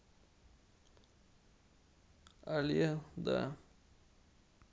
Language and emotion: Russian, sad